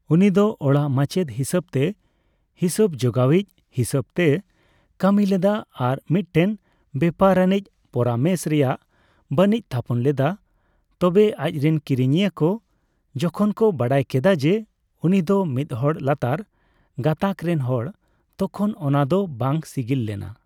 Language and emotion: Santali, neutral